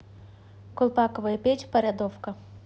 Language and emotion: Russian, neutral